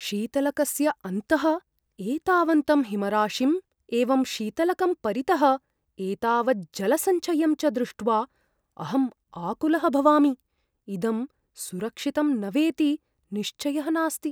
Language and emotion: Sanskrit, fearful